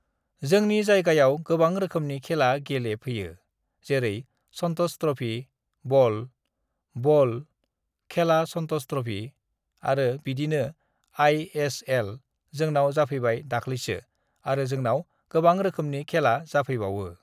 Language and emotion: Bodo, neutral